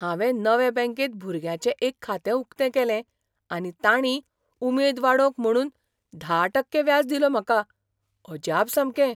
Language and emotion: Goan Konkani, surprised